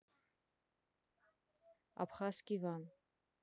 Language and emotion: Russian, neutral